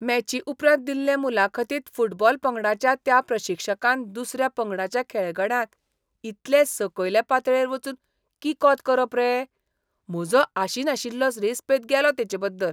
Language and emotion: Goan Konkani, disgusted